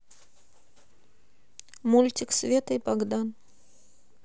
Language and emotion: Russian, neutral